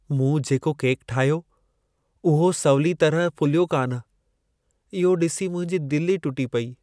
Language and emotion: Sindhi, sad